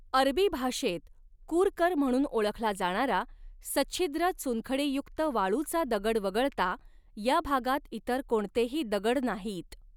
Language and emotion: Marathi, neutral